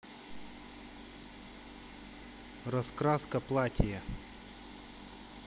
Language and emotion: Russian, neutral